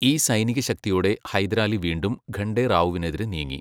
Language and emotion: Malayalam, neutral